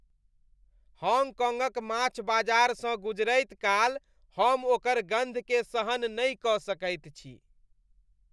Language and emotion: Maithili, disgusted